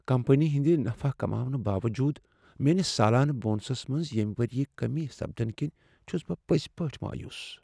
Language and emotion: Kashmiri, sad